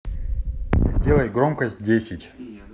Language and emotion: Russian, neutral